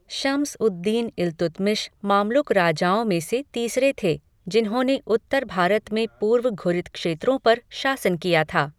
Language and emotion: Hindi, neutral